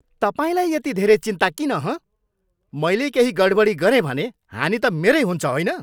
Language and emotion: Nepali, angry